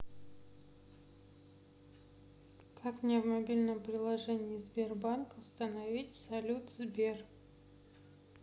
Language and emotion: Russian, neutral